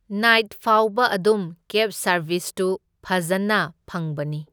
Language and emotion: Manipuri, neutral